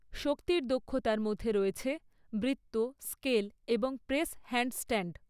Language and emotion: Bengali, neutral